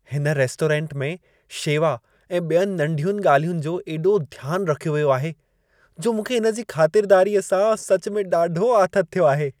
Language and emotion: Sindhi, happy